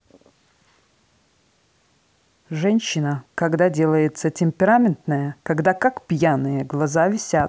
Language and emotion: Russian, neutral